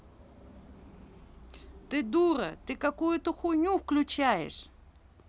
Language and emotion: Russian, angry